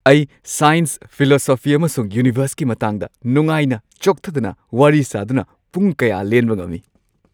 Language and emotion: Manipuri, happy